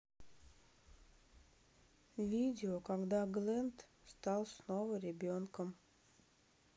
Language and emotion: Russian, sad